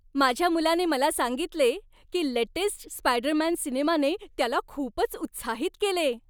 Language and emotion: Marathi, happy